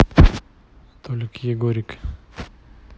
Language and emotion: Russian, neutral